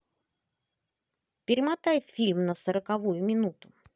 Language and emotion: Russian, positive